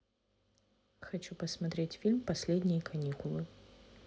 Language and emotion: Russian, neutral